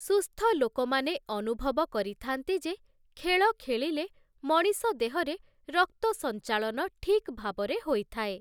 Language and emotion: Odia, neutral